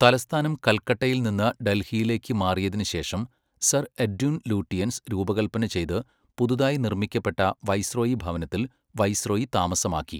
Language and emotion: Malayalam, neutral